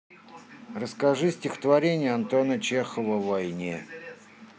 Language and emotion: Russian, neutral